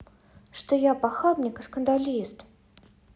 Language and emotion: Russian, neutral